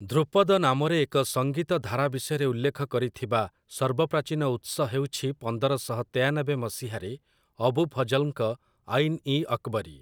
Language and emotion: Odia, neutral